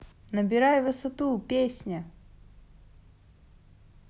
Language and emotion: Russian, positive